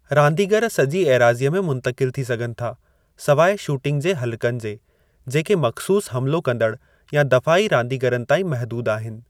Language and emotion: Sindhi, neutral